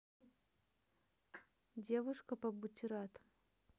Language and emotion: Russian, neutral